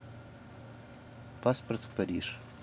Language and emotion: Russian, neutral